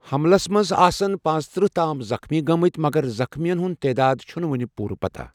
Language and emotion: Kashmiri, neutral